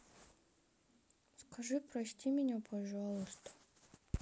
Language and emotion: Russian, sad